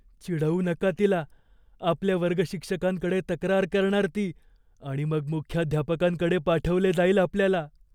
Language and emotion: Marathi, fearful